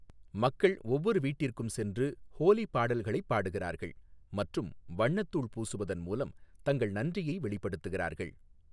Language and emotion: Tamil, neutral